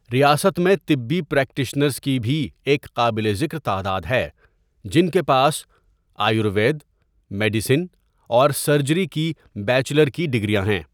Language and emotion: Urdu, neutral